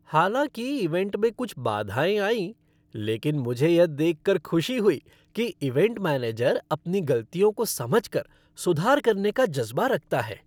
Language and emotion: Hindi, happy